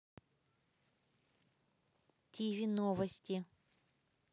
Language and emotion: Russian, neutral